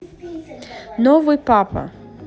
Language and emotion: Russian, positive